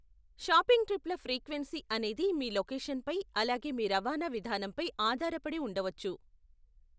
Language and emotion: Telugu, neutral